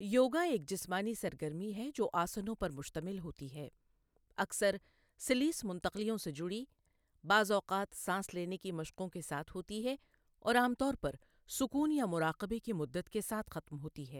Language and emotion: Urdu, neutral